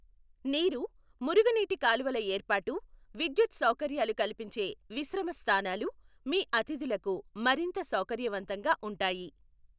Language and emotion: Telugu, neutral